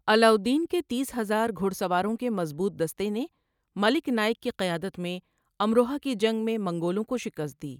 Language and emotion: Urdu, neutral